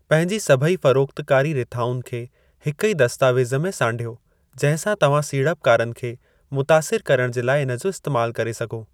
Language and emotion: Sindhi, neutral